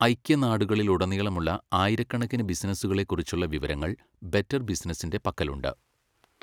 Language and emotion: Malayalam, neutral